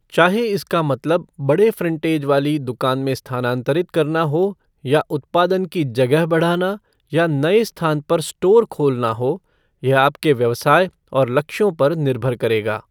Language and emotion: Hindi, neutral